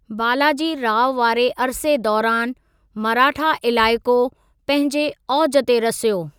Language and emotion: Sindhi, neutral